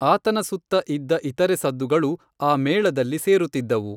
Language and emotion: Kannada, neutral